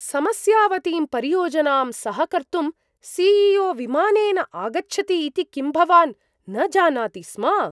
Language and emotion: Sanskrit, surprised